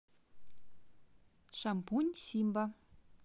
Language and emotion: Russian, positive